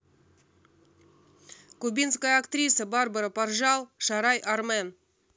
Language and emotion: Russian, neutral